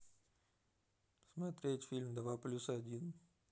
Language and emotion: Russian, neutral